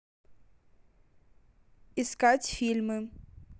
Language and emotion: Russian, neutral